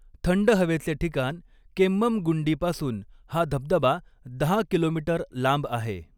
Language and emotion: Marathi, neutral